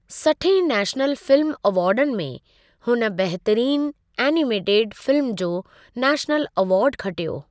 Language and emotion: Sindhi, neutral